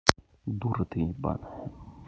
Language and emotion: Russian, angry